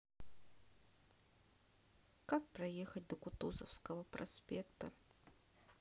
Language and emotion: Russian, sad